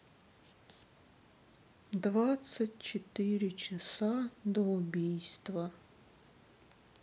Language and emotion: Russian, sad